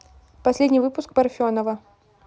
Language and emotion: Russian, neutral